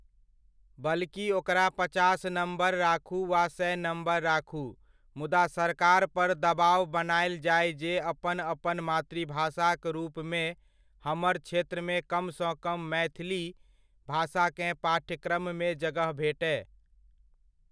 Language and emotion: Maithili, neutral